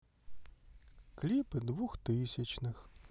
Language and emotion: Russian, sad